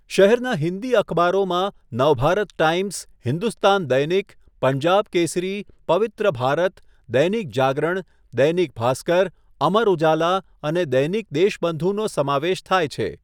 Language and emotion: Gujarati, neutral